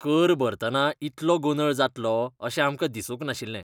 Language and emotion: Goan Konkani, disgusted